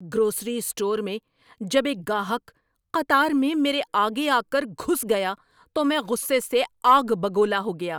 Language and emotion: Urdu, angry